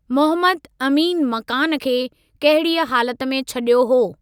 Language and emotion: Sindhi, neutral